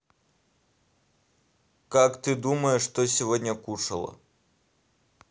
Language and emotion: Russian, neutral